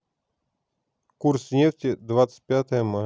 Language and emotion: Russian, neutral